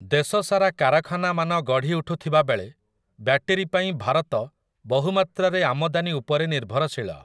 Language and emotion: Odia, neutral